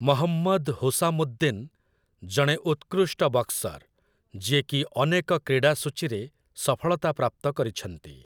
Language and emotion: Odia, neutral